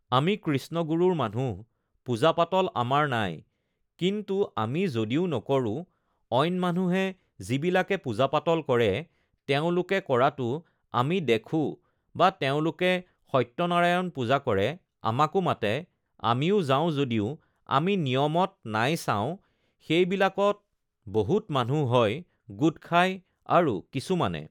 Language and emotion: Assamese, neutral